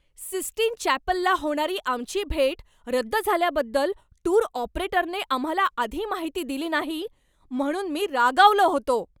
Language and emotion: Marathi, angry